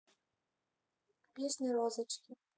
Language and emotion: Russian, neutral